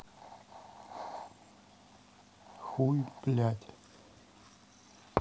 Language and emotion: Russian, neutral